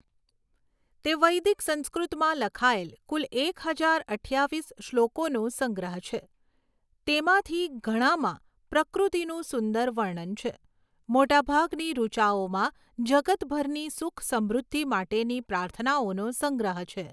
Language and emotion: Gujarati, neutral